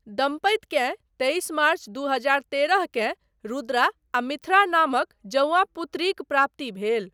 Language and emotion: Maithili, neutral